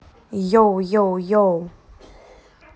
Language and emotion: Russian, positive